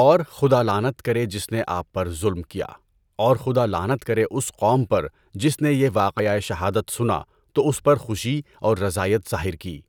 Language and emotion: Urdu, neutral